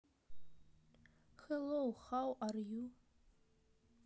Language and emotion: Russian, neutral